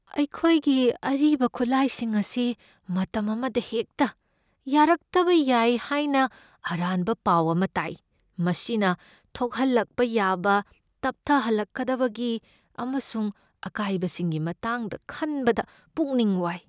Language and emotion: Manipuri, fearful